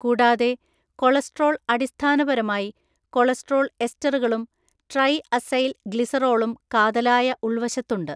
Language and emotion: Malayalam, neutral